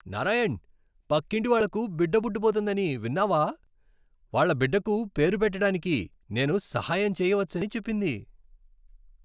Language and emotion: Telugu, happy